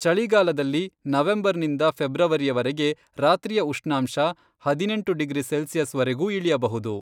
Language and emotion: Kannada, neutral